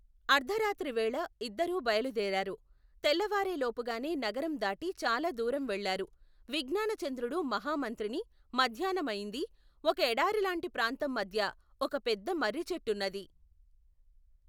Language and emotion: Telugu, neutral